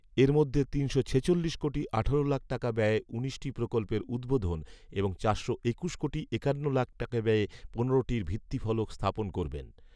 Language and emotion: Bengali, neutral